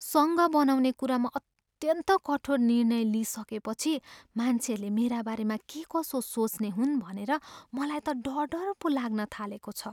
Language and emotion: Nepali, fearful